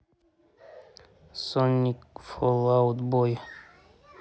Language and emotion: Russian, neutral